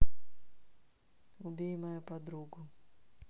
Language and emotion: Russian, neutral